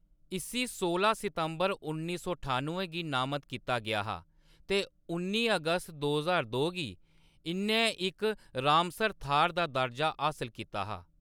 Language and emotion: Dogri, neutral